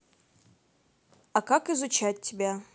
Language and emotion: Russian, neutral